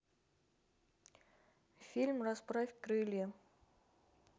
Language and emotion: Russian, neutral